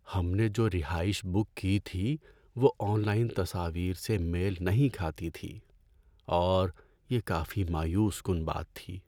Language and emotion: Urdu, sad